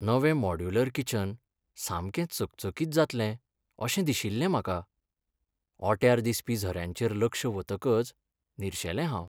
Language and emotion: Goan Konkani, sad